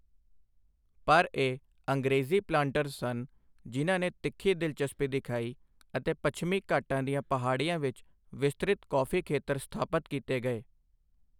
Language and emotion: Punjabi, neutral